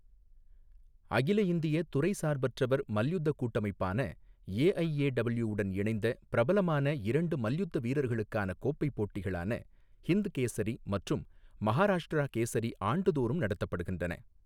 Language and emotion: Tamil, neutral